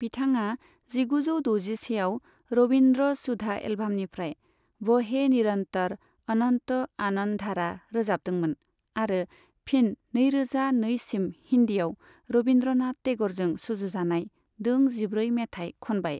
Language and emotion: Bodo, neutral